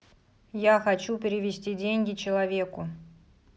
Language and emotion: Russian, angry